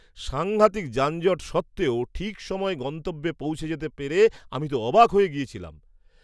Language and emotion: Bengali, surprised